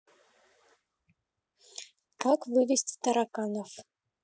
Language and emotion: Russian, neutral